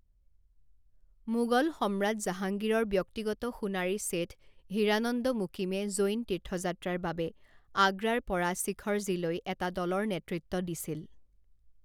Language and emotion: Assamese, neutral